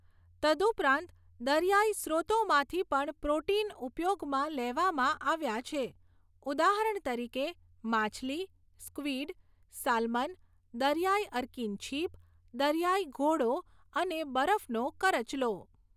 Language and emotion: Gujarati, neutral